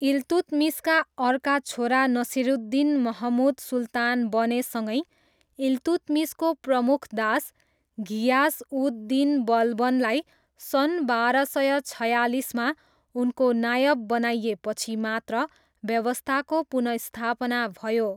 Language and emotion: Nepali, neutral